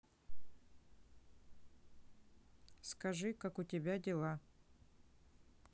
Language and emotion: Russian, neutral